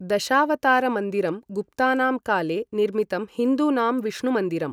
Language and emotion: Sanskrit, neutral